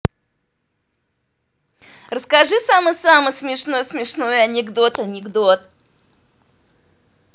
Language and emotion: Russian, positive